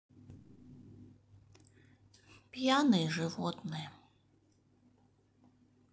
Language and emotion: Russian, sad